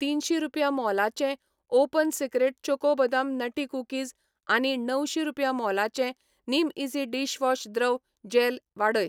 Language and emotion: Goan Konkani, neutral